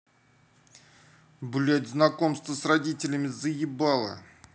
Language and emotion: Russian, angry